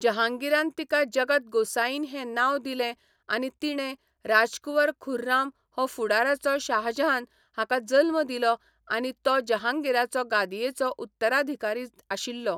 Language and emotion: Goan Konkani, neutral